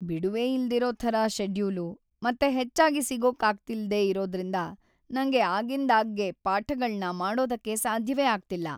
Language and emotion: Kannada, sad